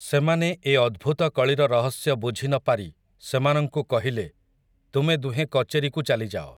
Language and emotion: Odia, neutral